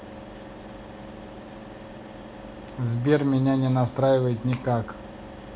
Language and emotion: Russian, neutral